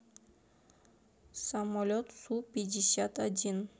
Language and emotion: Russian, neutral